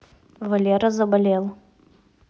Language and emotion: Russian, neutral